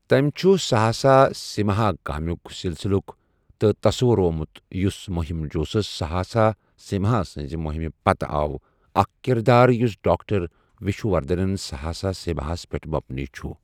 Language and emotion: Kashmiri, neutral